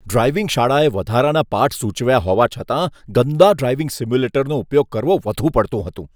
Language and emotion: Gujarati, disgusted